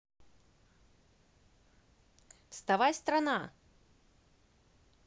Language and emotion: Russian, positive